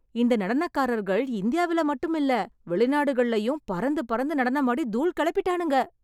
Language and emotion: Tamil, surprised